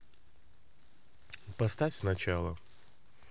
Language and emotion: Russian, neutral